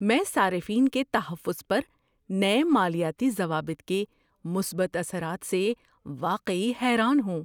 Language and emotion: Urdu, surprised